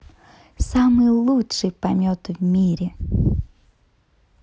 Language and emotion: Russian, positive